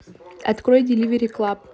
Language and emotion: Russian, neutral